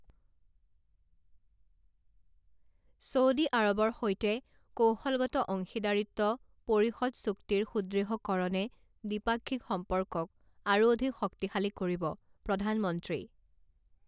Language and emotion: Assamese, neutral